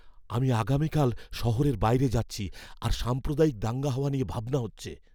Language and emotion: Bengali, fearful